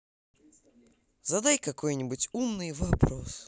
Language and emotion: Russian, positive